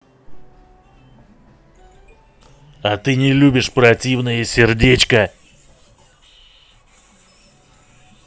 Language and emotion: Russian, angry